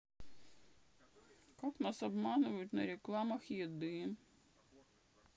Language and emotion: Russian, sad